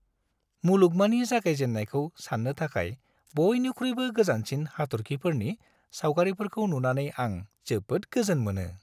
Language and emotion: Bodo, happy